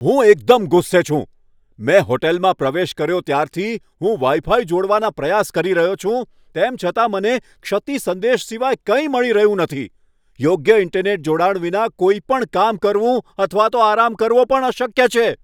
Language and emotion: Gujarati, angry